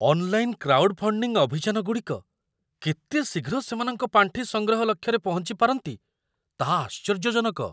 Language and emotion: Odia, surprised